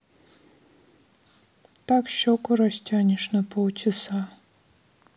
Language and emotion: Russian, sad